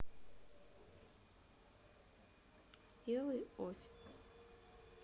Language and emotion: Russian, neutral